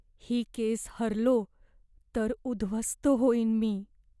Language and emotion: Marathi, fearful